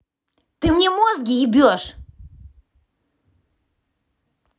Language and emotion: Russian, angry